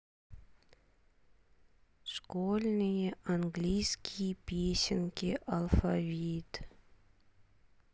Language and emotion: Russian, sad